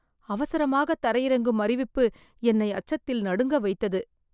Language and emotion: Tamil, fearful